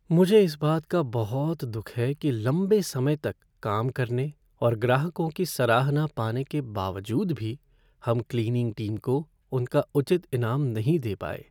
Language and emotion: Hindi, sad